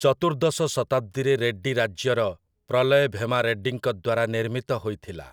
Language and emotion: Odia, neutral